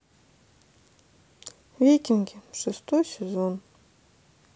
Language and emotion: Russian, sad